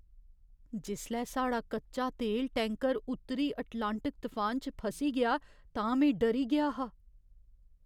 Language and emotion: Dogri, fearful